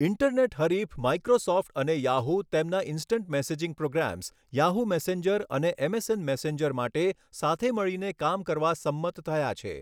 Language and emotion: Gujarati, neutral